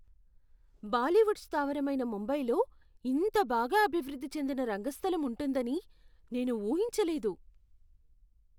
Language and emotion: Telugu, surprised